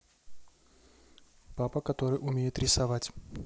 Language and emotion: Russian, neutral